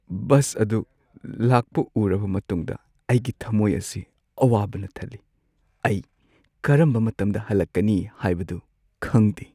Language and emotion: Manipuri, sad